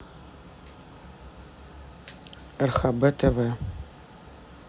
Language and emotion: Russian, neutral